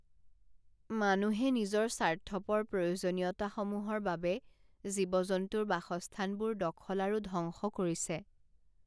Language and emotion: Assamese, sad